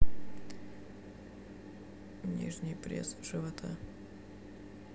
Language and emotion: Russian, sad